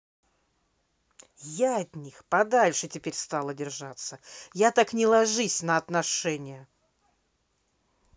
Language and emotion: Russian, angry